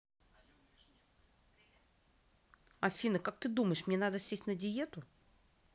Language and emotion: Russian, neutral